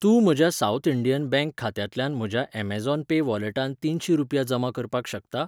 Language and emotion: Goan Konkani, neutral